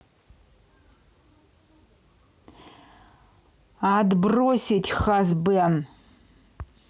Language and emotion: Russian, angry